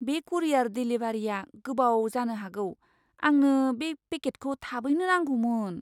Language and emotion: Bodo, fearful